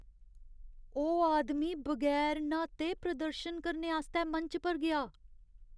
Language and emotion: Dogri, disgusted